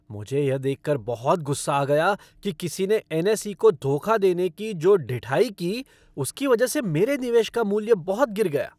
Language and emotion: Hindi, angry